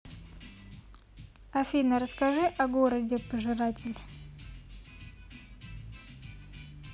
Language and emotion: Russian, neutral